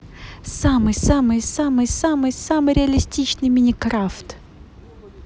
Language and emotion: Russian, positive